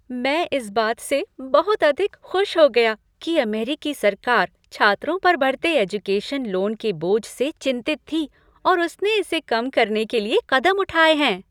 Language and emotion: Hindi, happy